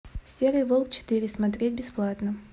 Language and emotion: Russian, neutral